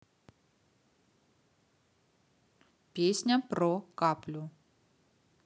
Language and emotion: Russian, neutral